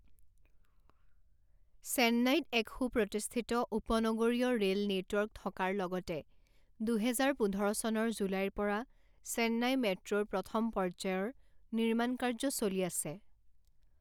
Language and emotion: Assamese, neutral